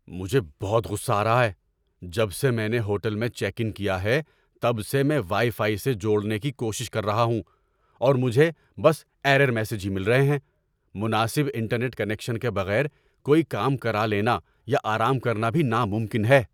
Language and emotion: Urdu, angry